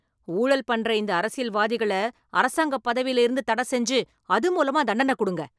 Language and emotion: Tamil, angry